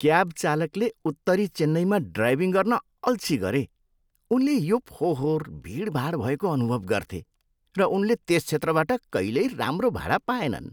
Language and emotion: Nepali, disgusted